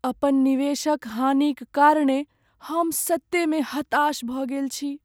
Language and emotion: Maithili, sad